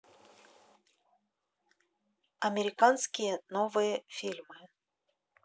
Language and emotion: Russian, neutral